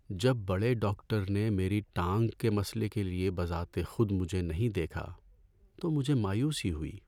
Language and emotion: Urdu, sad